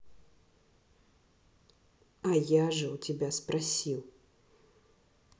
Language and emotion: Russian, neutral